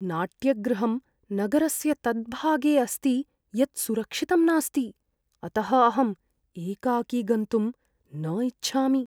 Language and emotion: Sanskrit, fearful